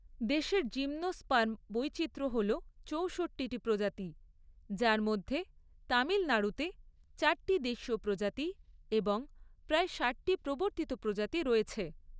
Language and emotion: Bengali, neutral